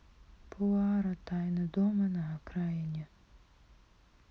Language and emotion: Russian, sad